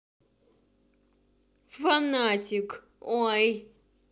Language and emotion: Russian, angry